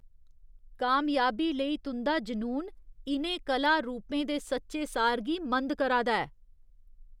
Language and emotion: Dogri, disgusted